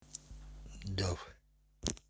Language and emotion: Russian, neutral